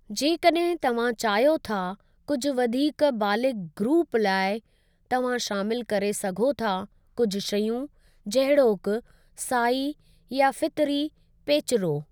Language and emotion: Sindhi, neutral